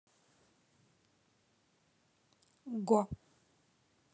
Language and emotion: Russian, neutral